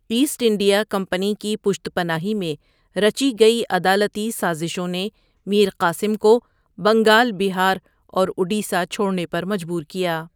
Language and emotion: Urdu, neutral